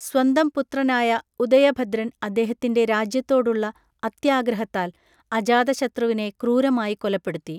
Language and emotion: Malayalam, neutral